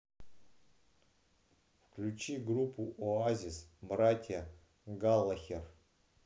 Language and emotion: Russian, neutral